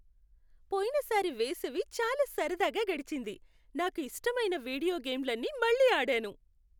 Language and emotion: Telugu, happy